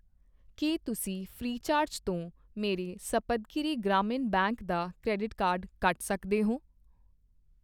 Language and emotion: Punjabi, neutral